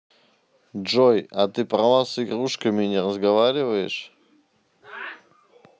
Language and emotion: Russian, neutral